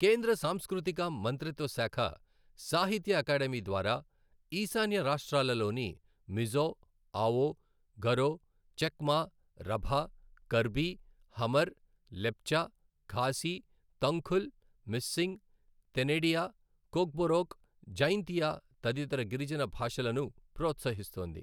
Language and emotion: Telugu, neutral